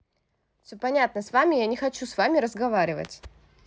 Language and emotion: Russian, angry